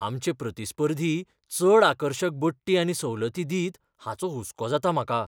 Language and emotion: Goan Konkani, fearful